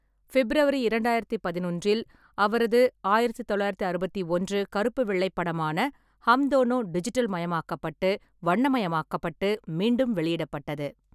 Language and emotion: Tamil, neutral